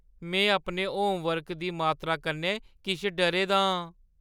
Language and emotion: Dogri, fearful